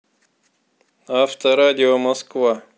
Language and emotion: Russian, neutral